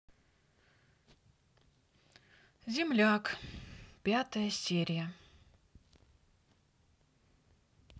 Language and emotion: Russian, sad